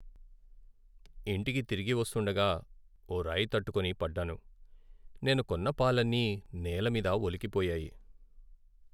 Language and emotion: Telugu, sad